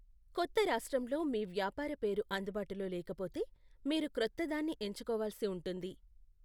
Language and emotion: Telugu, neutral